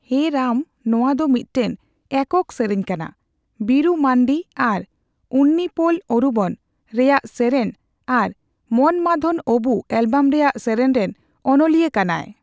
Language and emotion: Santali, neutral